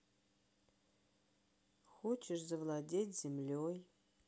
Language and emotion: Russian, sad